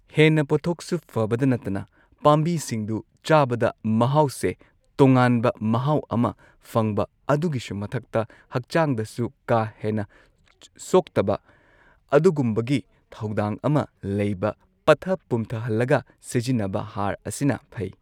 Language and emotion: Manipuri, neutral